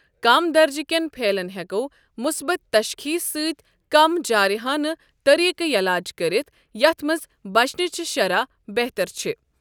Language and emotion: Kashmiri, neutral